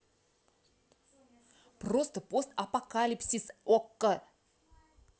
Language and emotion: Russian, angry